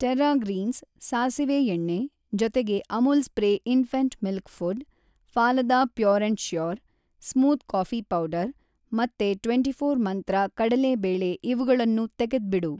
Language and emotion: Kannada, neutral